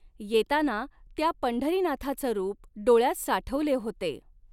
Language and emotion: Marathi, neutral